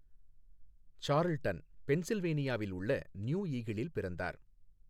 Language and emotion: Tamil, neutral